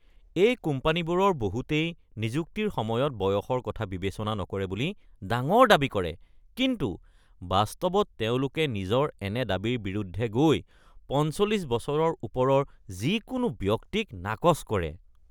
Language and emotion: Assamese, disgusted